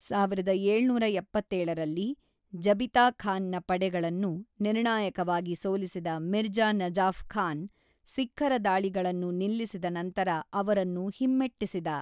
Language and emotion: Kannada, neutral